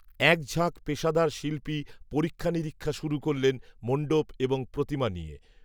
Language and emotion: Bengali, neutral